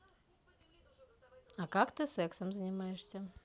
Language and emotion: Russian, neutral